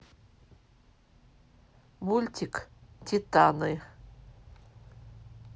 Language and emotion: Russian, neutral